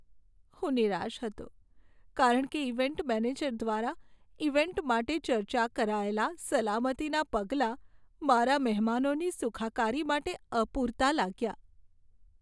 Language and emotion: Gujarati, sad